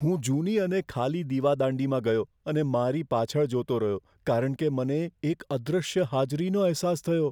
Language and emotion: Gujarati, fearful